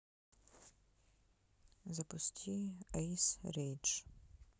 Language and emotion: Russian, neutral